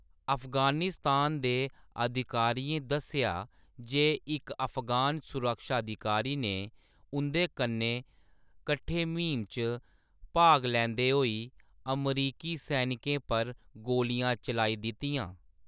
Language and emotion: Dogri, neutral